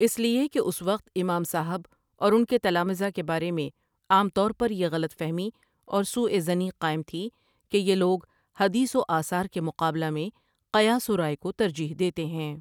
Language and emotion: Urdu, neutral